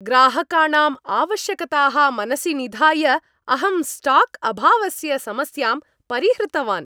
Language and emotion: Sanskrit, happy